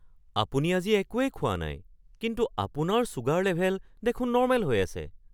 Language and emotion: Assamese, surprised